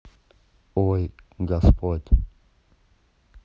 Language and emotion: Russian, neutral